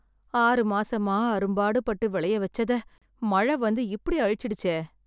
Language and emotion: Tamil, sad